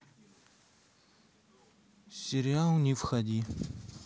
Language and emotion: Russian, neutral